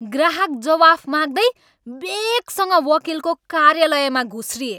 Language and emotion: Nepali, angry